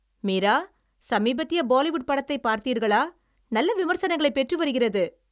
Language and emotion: Tamil, happy